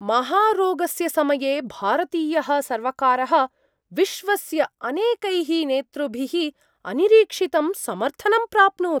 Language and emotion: Sanskrit, surprised